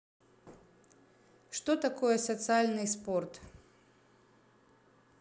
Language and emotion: Russian, neutral